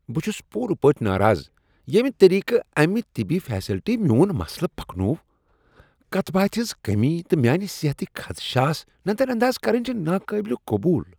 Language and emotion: Kashmiri, disgusted